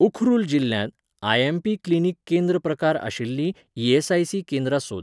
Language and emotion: Goan Konkani, neutral